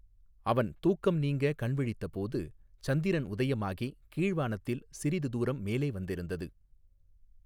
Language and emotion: Tamil, neutral